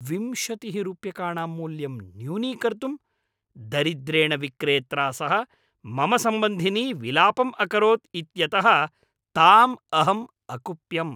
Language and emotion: Sanskrit, angry